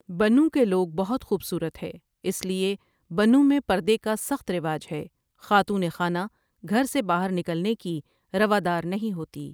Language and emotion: Urdu, neutral